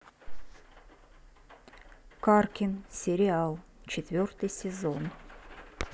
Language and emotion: Russian, neutral